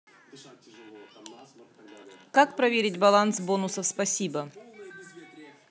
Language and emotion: Russian, neutral